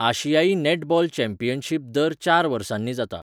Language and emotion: Goan Konkani, neutral